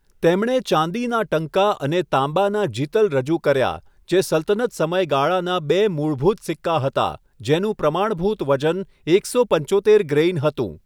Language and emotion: Gujarati, neutral